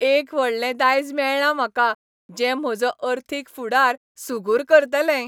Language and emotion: Goan Konkani, happy